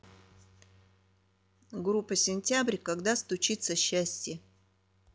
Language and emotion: Russian, neutral